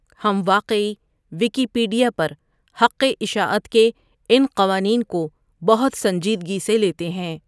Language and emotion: Urdu, neutral